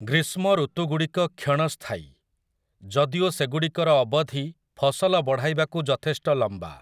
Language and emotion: Odia, neutral